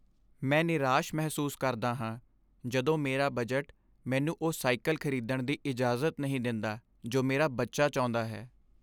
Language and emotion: Punjabi, sad